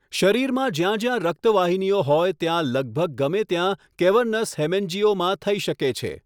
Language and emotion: Gujarati, neutral